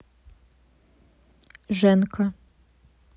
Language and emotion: Russian, neutral